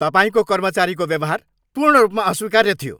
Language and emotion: Nepali, angry